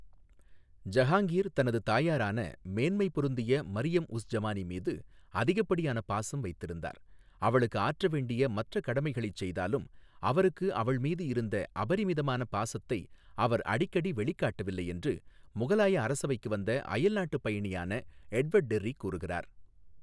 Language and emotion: Tamil, neutral